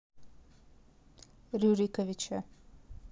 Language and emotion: Russian, neutral